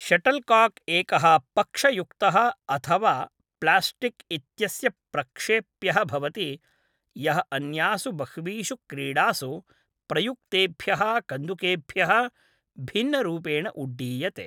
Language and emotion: Sanskrit, neutral